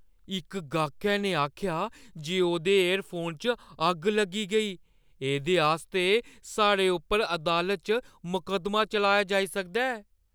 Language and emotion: Dogri, fearful